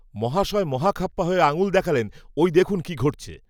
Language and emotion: Bengali, neutral